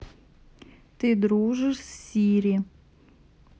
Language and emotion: Russian, neutral